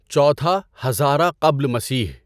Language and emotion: Urdu, neutral